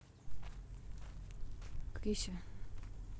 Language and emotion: Russian, neutral